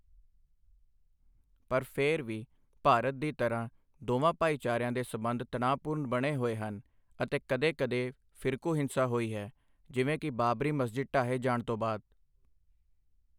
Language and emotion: Punjabi, neutral